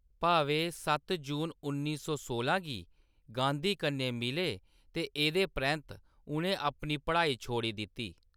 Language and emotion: Dogri, neutral